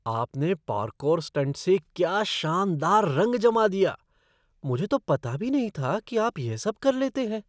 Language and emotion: Hindi, surprised